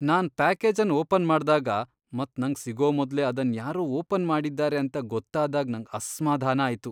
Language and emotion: Kannada, disgusted